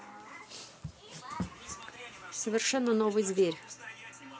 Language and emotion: Russian, neutral